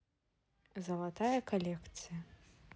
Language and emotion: Russian, neutral